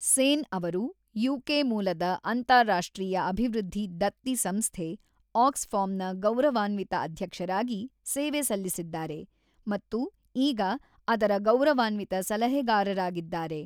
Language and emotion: Kannada, neutral